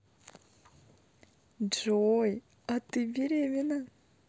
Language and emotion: Russian, positive